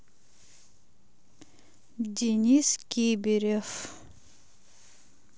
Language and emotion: Russian, neutral